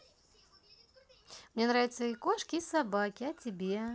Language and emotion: Russian, positive